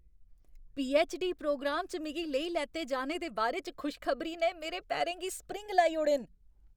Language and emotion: Dogri, happy